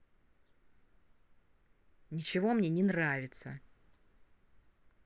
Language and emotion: Russian, angry